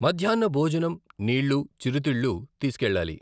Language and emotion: Telugu, neutral